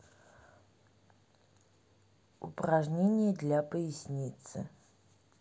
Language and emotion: Russian, neutral